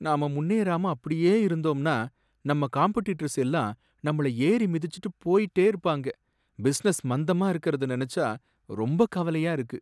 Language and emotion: Tamil, sad